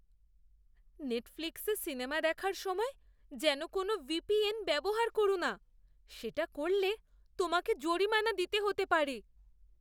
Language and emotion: Bengali, fearful